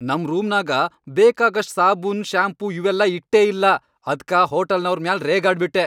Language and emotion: Kannada, angry